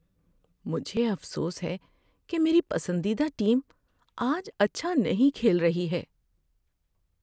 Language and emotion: Urdu, sad